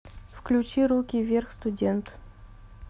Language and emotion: Russian, neutral